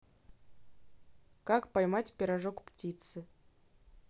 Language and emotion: Russian, neutral